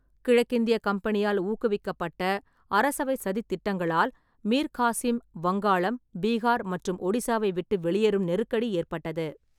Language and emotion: Tamil, neutral